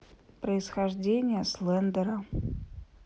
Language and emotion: Russian, neutral